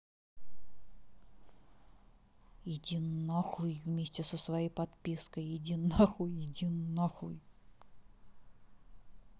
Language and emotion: Russian, angry